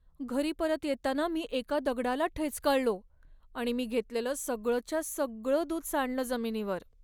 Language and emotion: Marathi, sad